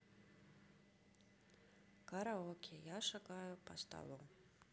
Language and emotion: Russian, neutral